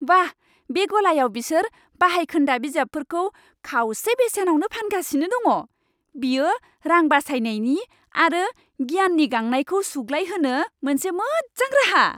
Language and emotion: Bodo, happy